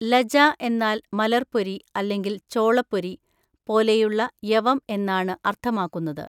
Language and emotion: Malayalam, neutral